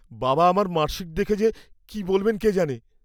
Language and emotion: Bengali, fearful